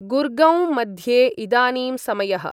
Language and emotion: Sanskrit, neutral